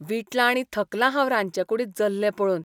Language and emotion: Goan Konkani, disgusted